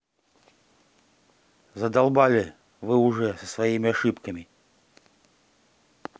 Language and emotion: Russian, angry